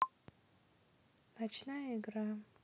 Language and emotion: Russian, neutral